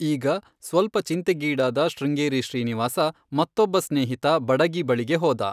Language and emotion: Kannada, neutral